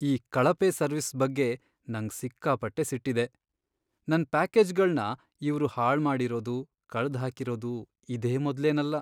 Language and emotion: Kannada, sad